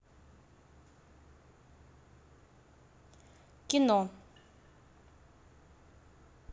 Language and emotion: Russian, neutral